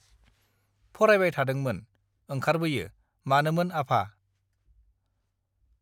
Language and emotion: Bodo, neutral